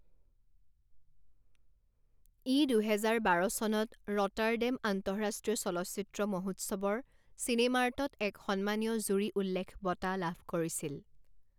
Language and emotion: Assamese, neutral